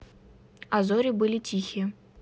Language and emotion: Russian, neutral